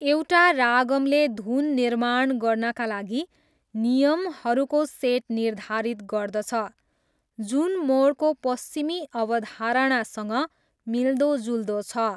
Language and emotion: Nepali, neutral